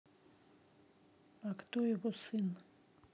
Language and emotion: Russian, neutral